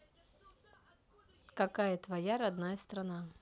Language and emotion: Russian, neutral